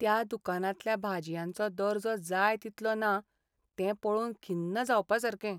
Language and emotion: Goan Konkani, sad